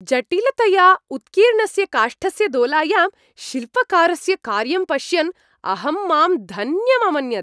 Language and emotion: Sanskrit, happy